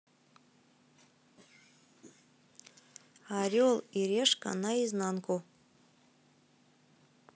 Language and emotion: Russian, neutral